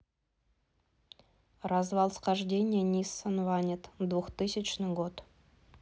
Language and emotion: Russian, neutral